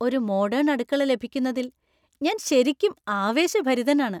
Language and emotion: Malayalam, happy